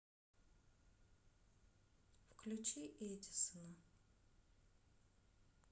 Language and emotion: Russian, neutral